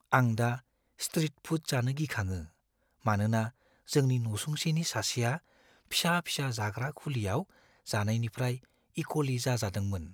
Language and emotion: Bodo, fearful